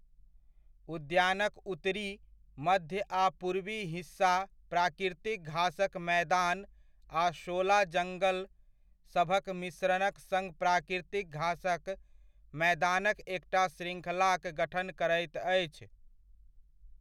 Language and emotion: Maithili, neutral